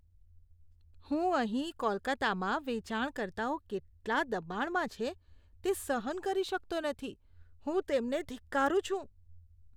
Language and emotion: Gujarati, disgusted